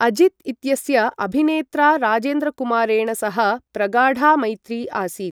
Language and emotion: Sanskrit, neutral